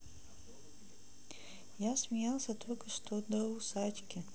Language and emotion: Russian, neutral